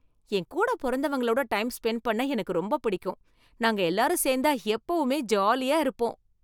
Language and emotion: Tamil, happy